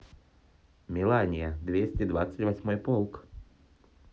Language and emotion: Russian, neutral